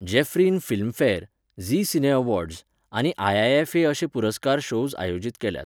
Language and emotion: Goan Konkani, neutral